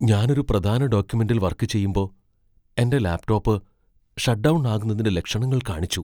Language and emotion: Malayalam, fearful